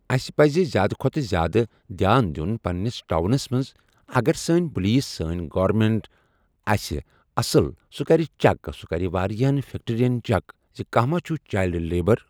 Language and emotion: Kashmiri, neutral